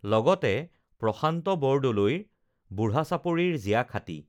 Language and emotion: Assamese, neutral